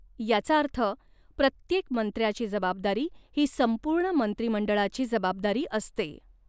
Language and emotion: Marathi, neutral